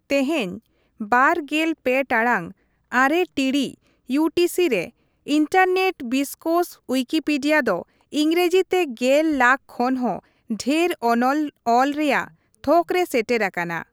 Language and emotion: Santali, neutral